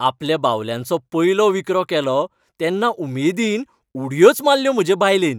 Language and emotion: Goan Konkani, happy